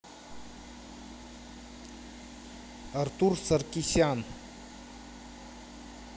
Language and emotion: Russian, neutral